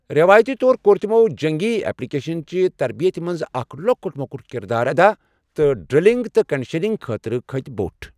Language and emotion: Kashmiri, neutral